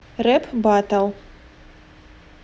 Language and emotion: Russian, neutral